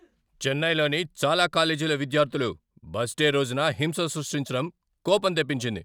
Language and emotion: Telugu, angry